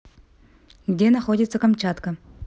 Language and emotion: Russian, neutral